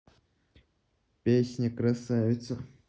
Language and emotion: Russian, neutral